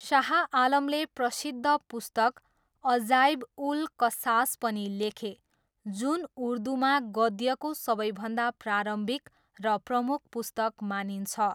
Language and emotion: Nepali, neutral